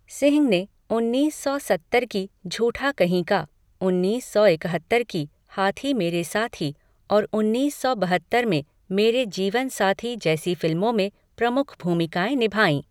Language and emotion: Hindi, neutral